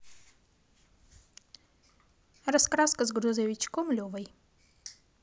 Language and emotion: Russian, positive